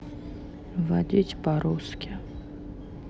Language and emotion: Russian, sad